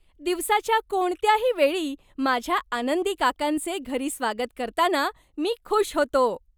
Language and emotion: Marathi, happy